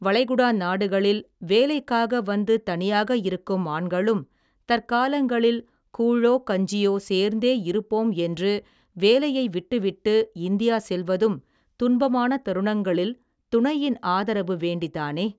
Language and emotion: Tamil, neutral